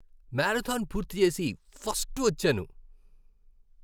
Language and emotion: Telugu, happy